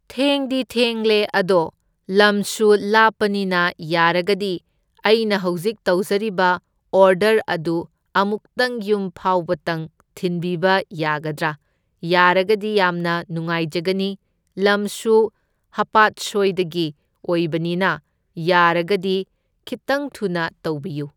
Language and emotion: Manipuri, neutral